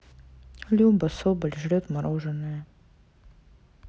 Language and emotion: Russian, neutral